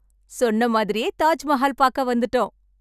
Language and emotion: Tamil, happy